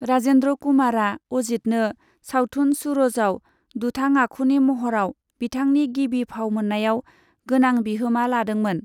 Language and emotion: Bodo, neutral